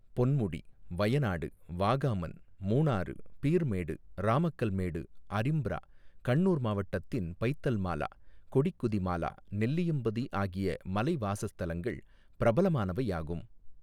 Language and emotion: Tamil, neutral